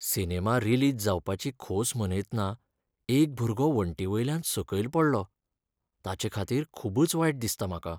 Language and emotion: Goan Konkani, sad